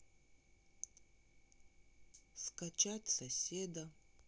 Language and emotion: Russian, sad